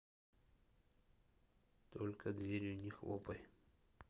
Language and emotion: Russian, neutral